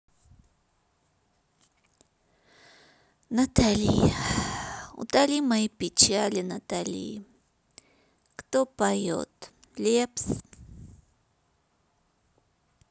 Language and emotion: Russian, sad